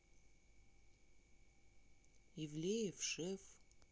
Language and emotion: Russian, neutral